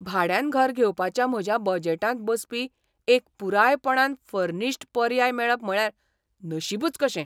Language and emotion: Goan Konkani, surprised